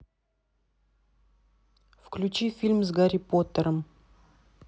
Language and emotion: Russian, neutral